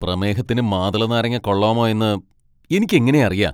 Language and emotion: Malayalam, angry